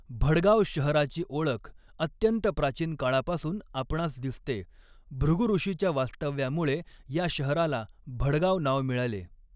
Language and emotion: Marathi, neutral